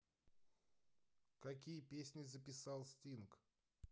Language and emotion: Russian, neutral